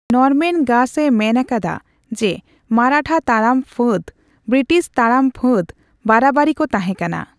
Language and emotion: Santali, neutral